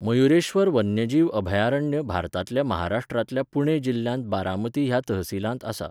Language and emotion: Goan Konkani, neutral